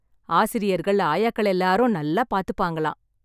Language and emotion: Tamil, happy